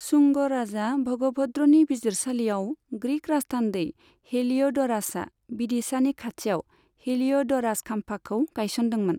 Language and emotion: Bodo, neutral